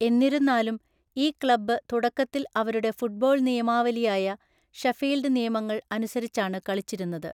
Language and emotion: Malayalam, neutral